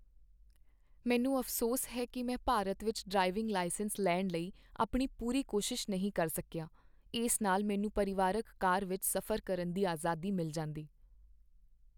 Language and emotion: Punjabi, sad